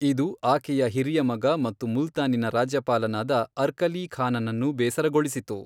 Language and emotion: Kannada, neutral